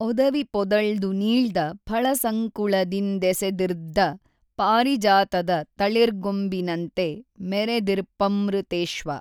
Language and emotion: Kannada, neutral